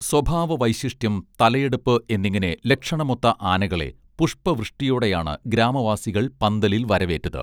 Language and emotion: Malayalam, neutral